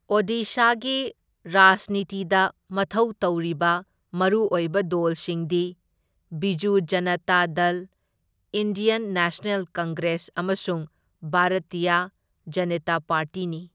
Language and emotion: Manipuri, neutral